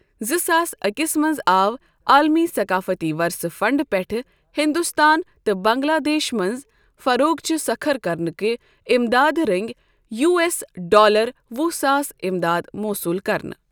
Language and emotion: Kashmiri, neutral